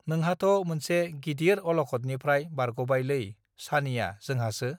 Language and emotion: Bodo, neutral